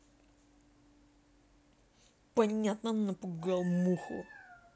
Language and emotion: Russian, angry